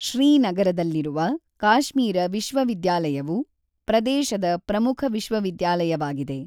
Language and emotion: Kannada, neutral